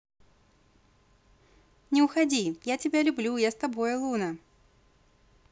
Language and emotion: Russian, positive